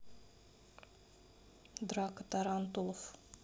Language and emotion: Russian, neutral